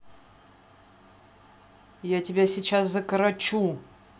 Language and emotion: Russian, angry